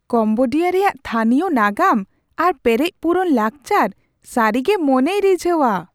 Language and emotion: Santali, surprised